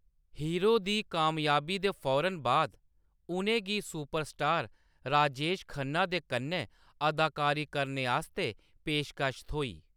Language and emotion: Dogri, neutral